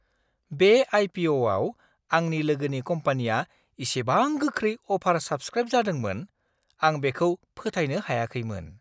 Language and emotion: Bodo, surprised